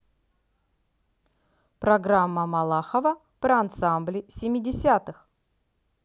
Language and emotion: Russian, positive